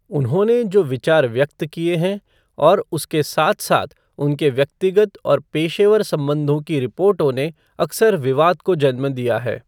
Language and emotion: Hindi, neutral